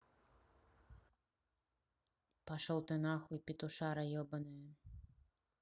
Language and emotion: Russian, angry